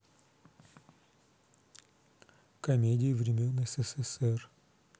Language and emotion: Russian, neutral